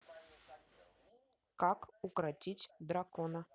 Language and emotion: Russian, neutral